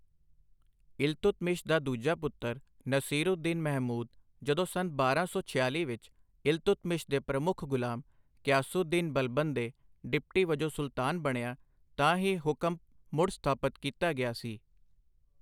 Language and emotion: Punjabi, neutral